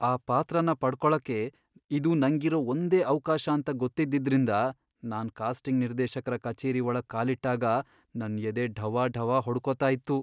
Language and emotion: Kannada, fearful